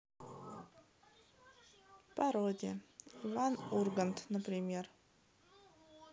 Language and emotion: Russian, neutral